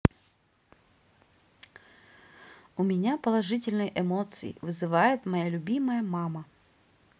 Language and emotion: Russian, positive